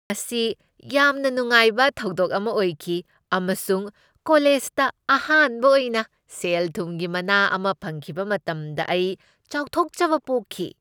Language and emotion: Manipuri, happy